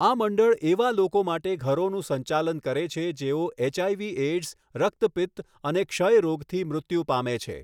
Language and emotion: Gujarati, neutral